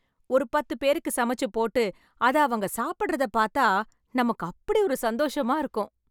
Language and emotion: Tamil, happy